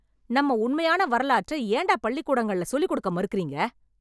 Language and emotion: Tamil, angry